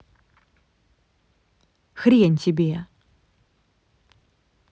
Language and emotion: Russian, angry